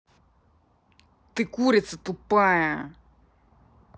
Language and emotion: Russian, angry